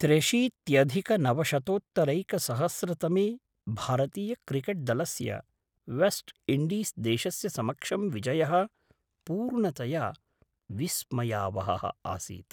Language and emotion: Sanskrit, surprised